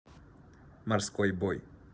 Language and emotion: Russian, neutral